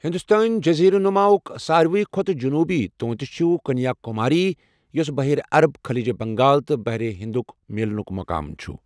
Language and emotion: Kashmiri, neutral